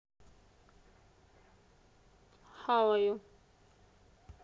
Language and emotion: Russian, neutral